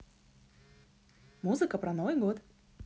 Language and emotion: Russian, positive